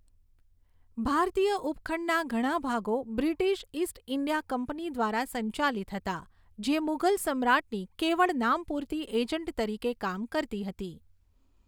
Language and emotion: Gujarati, neutral